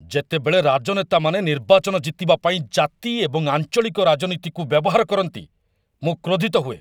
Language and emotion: Odia, angry